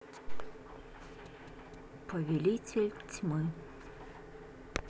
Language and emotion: Russian, neutral